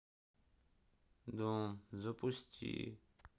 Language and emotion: Russian, sad